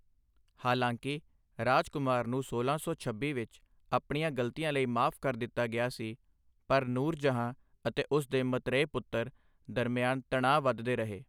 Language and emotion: Punjabi, neutral